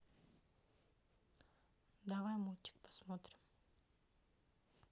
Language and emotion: Russian, neutral